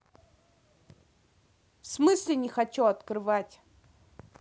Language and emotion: Russian, angry